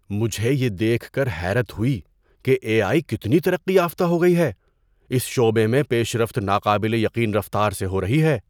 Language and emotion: Urdu, surprised